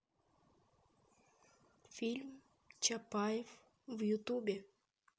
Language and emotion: Russian, neutral